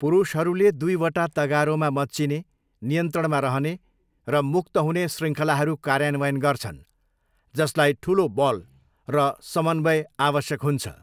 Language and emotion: Nepali, neutral